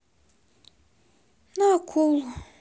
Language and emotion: Russian, sad